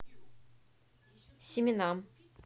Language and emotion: Russian, neutral